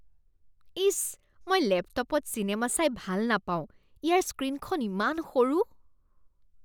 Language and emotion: Assamese, disgusted